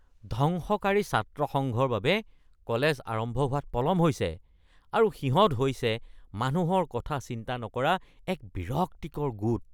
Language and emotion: Assamese, disgusted